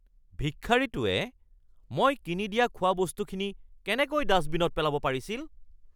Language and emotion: Assamese, angry